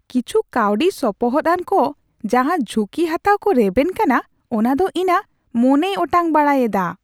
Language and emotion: Santali, surprised